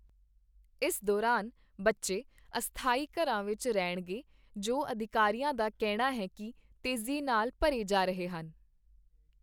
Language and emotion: Punjabi, neutral